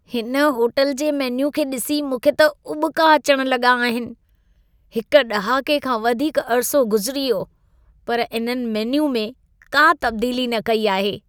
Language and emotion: Sindhi, disgusted